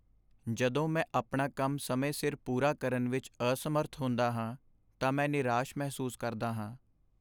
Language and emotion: Punjabi, sad